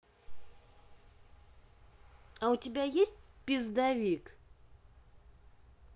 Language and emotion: Russian, neutral